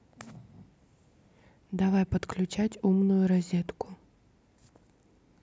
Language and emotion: Russian, neutral